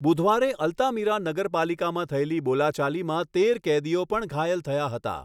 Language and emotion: Gujarati, neutral